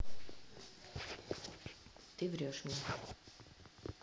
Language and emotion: Russian, neutral